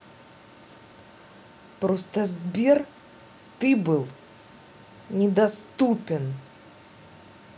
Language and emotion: Russian, angry